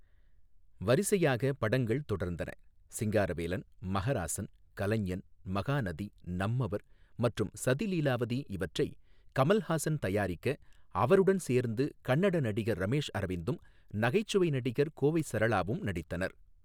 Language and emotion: Tamil, neutral